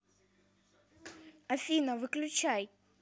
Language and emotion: Russian, neutral